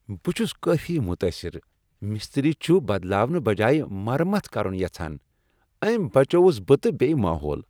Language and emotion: Kashmiri, happy